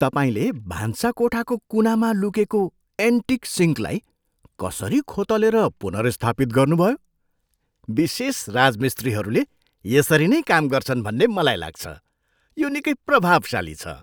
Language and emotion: Nepali, surprised